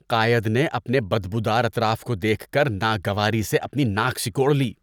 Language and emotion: Urdu, disgusted